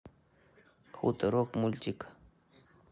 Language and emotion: Russian, neutral